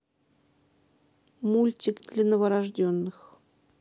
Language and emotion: Russian, neutral